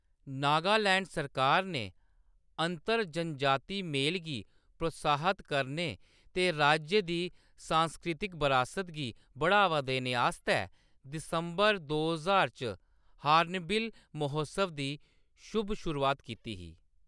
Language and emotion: Dogri, neutral